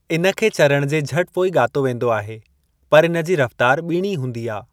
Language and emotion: Sindhi, neutral